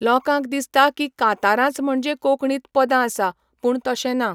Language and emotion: Goan Konkani, neutral